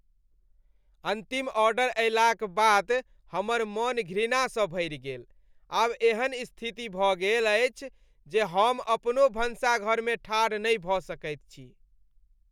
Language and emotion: Maithili, disgusted